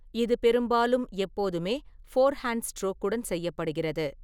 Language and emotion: Tamil, neutral